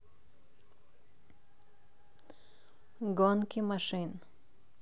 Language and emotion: Russian, neutral